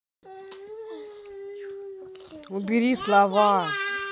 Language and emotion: Russian, angry